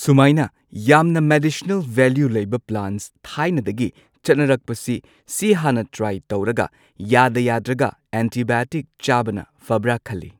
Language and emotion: Manipuri, neutral